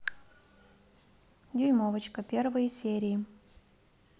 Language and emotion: Russian, neutral